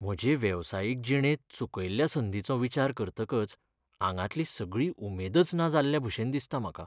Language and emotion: Goan Konkani, sad